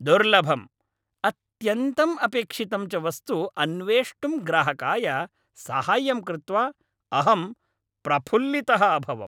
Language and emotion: Sanskrit, happy